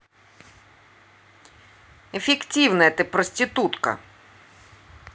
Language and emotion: Russian, angry